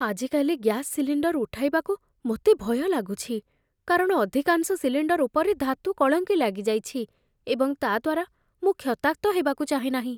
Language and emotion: Odia, fearful